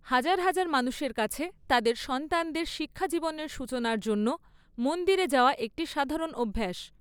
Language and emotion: Bengali, neutral